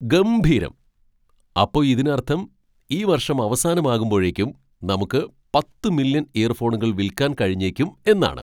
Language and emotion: Malayalam, surprised